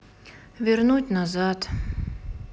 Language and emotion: Russian, sad